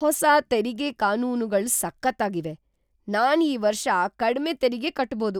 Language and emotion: Kannada, surprised